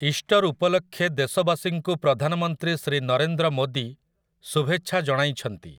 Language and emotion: Odia, neutral